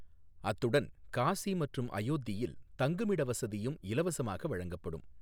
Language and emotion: Tamil, neutral